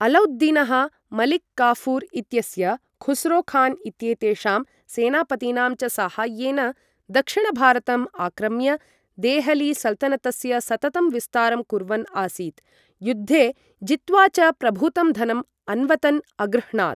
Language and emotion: Sanskrit, neutral